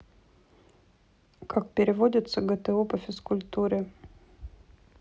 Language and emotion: Russian, neutral